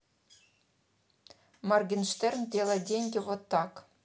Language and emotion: Russian, neutral